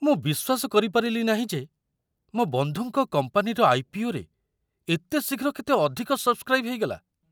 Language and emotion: Odia, surprised